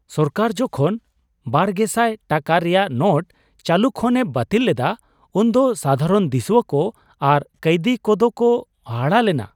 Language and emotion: Santali, surprised